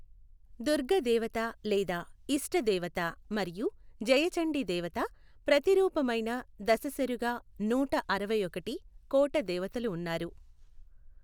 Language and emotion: Telugu, neutral